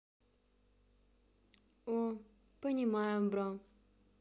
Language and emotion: Russian, sad